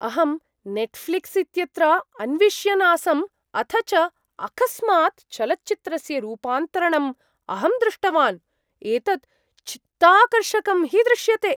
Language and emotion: Sanskrit, surprised